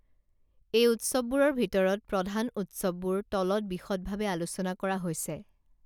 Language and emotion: Assamese, neutral